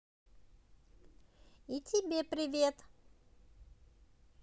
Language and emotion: Russian, positive